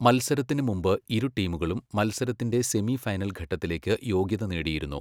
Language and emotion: Malayalam, neutral